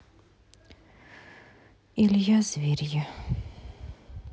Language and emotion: Russian, sad